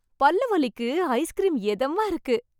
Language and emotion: Tamil, happy